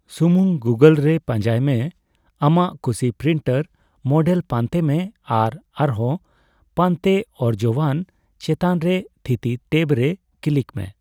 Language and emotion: Santali, neutral